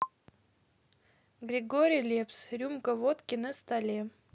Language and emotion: Russian, neutral